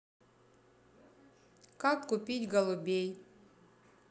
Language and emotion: Russian, neutral